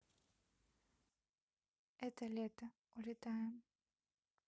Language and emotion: Russian, neutral